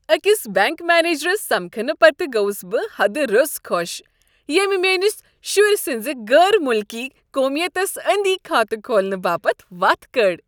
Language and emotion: Kashmiri, happy